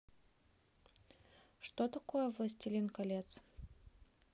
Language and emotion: Russian, neutral